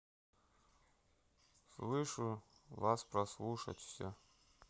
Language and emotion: Russian, neutral